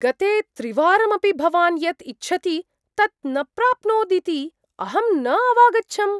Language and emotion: Sanskrit, surprised